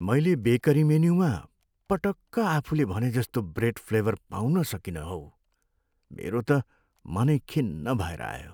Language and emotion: Nepali, sad